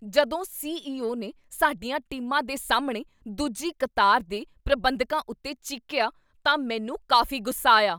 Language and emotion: Punjabi, angry